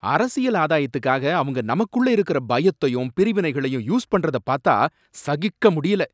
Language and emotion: Tamil, angry